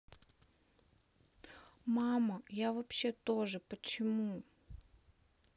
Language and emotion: Russian, sad